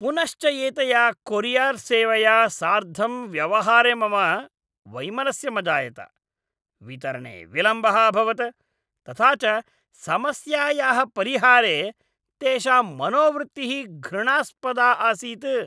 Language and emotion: Sanskrit, disgusted